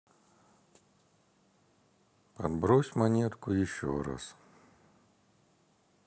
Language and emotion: Russian, sad